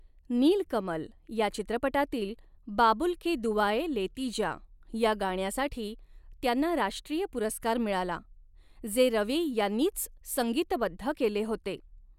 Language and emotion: Marathi, neutral